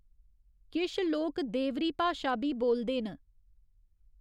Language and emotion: Dogri, neutral